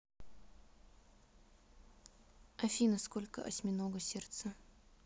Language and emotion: Russian, neutral